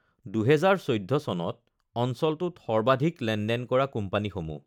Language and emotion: Assamese, neutral